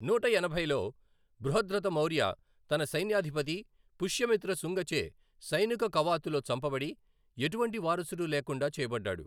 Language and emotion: Telugu, neutral